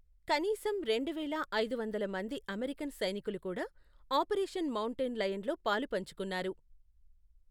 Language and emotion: Telugu, neutral